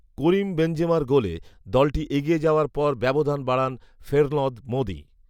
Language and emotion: Bengali, neutral